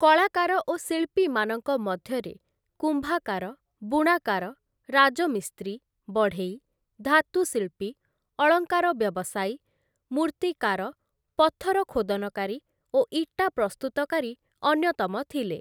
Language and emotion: Odia, neutral